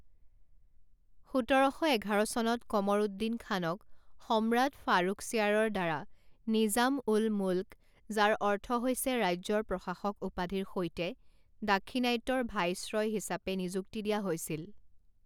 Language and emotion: Assamese, neutral